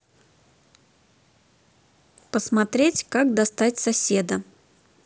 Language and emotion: Russian, neutral